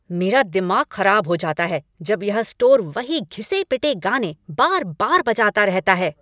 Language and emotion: Hindi, angry